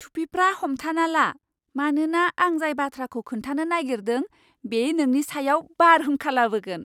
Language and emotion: Bodo, surprised